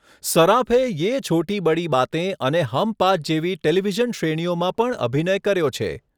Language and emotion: Gujarati, neutral